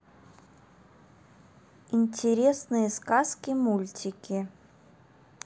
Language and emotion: Russian, neutral